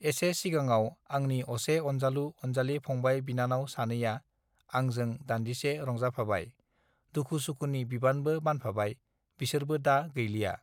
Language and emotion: Bodo, neutral